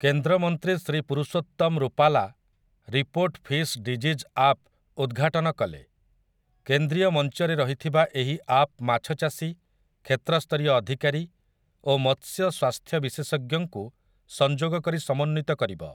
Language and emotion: Odia, neutral